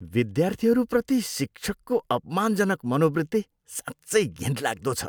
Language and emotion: Nepali, disgusted